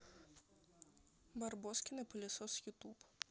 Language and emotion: Russian, neutral